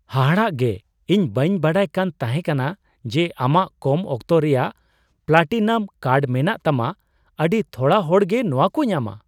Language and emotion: Santali, surprised